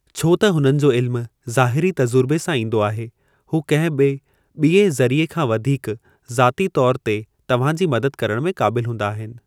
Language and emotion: Sindhi, neutral